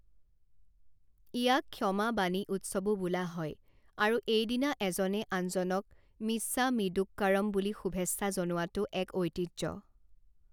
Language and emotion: Assamese, neutral